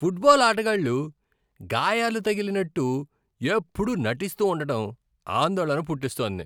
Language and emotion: Telugu, disgusted